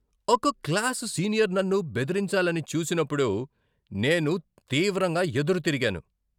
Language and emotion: Telugu, angry